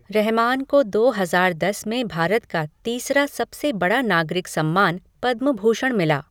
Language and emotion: Hindi, neutral